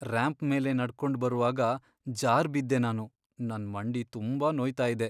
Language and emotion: Kannada, sad